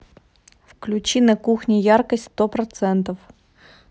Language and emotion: Russian, neutral